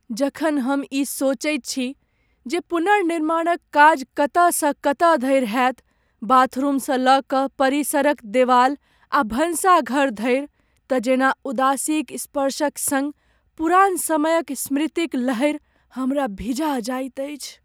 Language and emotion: Maithili, sad